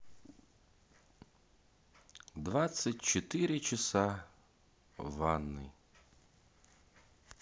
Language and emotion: Russian, sad